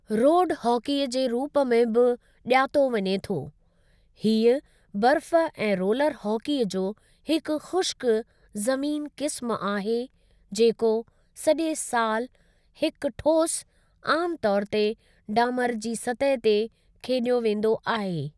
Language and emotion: Sindhi, neutral